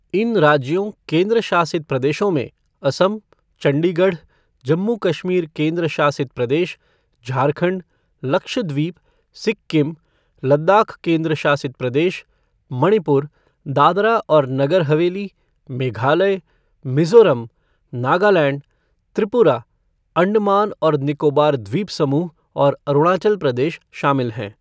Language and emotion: Hindi, neutral